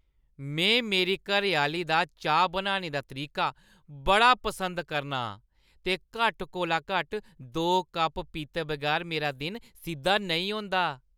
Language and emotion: Dogri, happy